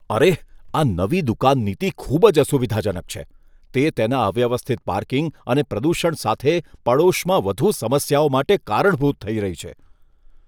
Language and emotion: Gujarati, disgusted